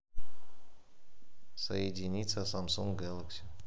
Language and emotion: Russian, neutral